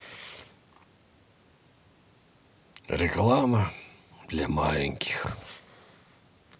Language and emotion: Russian, sad